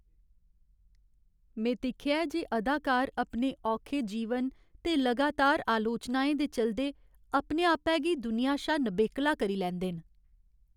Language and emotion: Dogri, sad